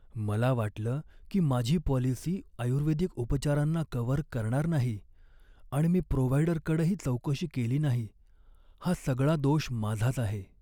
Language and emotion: Marathi, sad